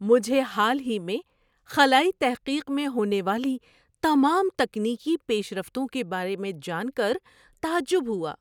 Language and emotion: Urdu, surprised